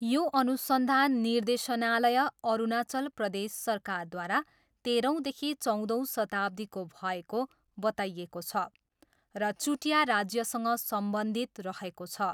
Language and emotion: Nepali, neutral